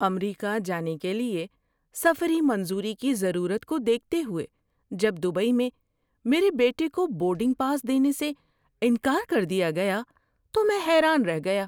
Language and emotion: Urdu, surprised